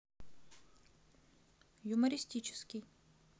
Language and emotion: Russian, neutral